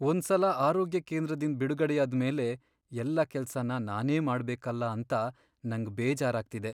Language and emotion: Kannada, sad